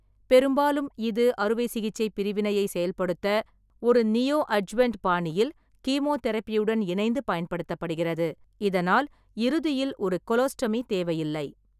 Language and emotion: Tamil, neutral